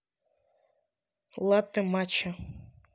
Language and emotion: Russian, neutral